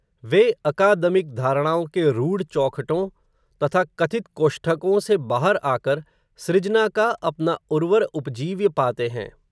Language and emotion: Hindi, neutral